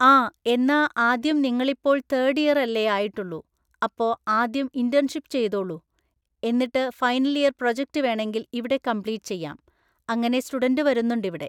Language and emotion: Malayalam, neutral